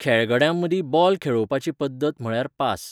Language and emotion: Goan Konkani, neutral